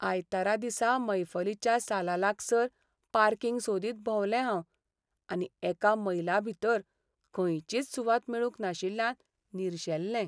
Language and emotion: Goan Konkani, sad